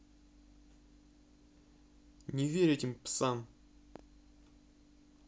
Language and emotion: Russian, neutral